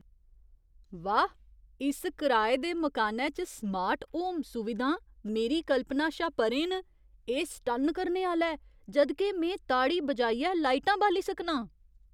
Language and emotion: Dogri, surprised